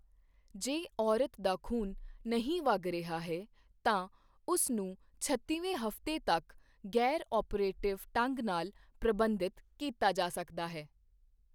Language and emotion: Punjabi, neutral